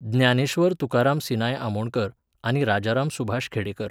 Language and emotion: Goan Konkani, neutral